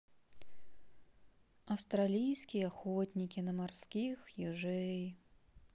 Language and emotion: Russian, sad